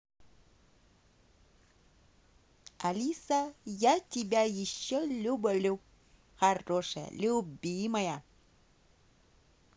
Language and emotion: Russian, positive